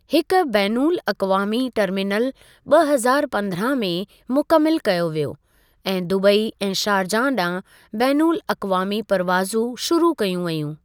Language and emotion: Sindhi, neutral